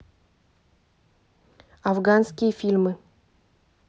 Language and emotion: Russian, neutral